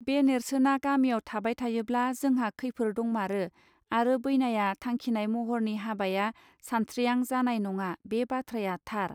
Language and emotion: Bodo, neutral